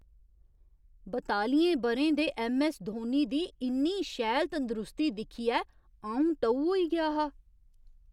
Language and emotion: Dogri, surprised